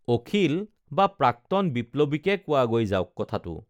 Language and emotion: Assamese, neutral